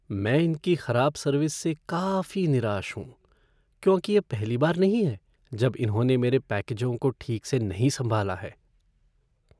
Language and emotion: Hindi, sad